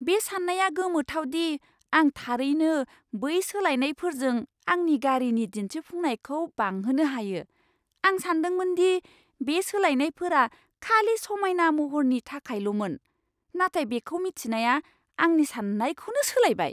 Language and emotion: Bodo, surprised